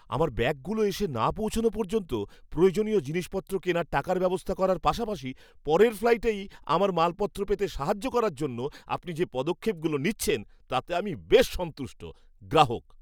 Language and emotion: Bengali, happy